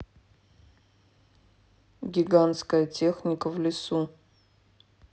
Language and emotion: Russian, neutral